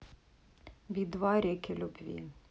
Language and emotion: Russian, neutral